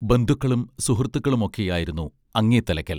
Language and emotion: Malayalam, neutral